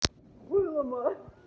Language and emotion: Russian, positive